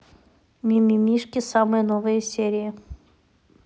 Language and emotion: Russian, neutral